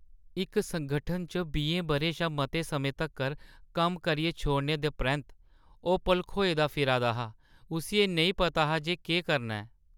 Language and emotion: Dogri, sad